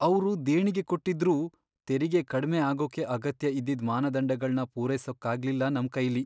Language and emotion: Kannada, sad